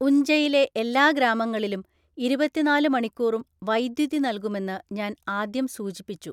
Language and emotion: Malayalam, neutral